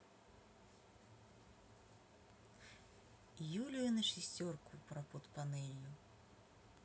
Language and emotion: Russian, neutral